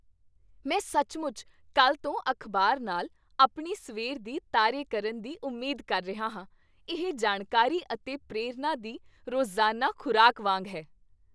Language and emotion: Punjabi, happy